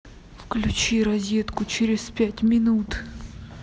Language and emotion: Russian, angry